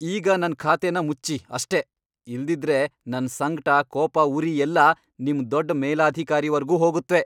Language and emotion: Kannada, angry